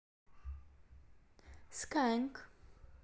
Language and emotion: Russian, neutral